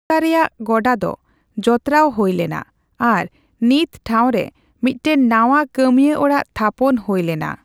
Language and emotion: Santali, neutral